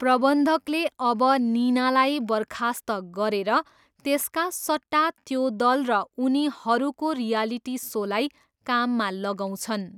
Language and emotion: Nepali, neutral